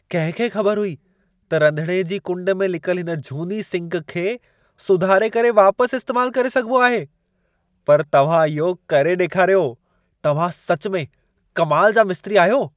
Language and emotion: Sindhi, surprised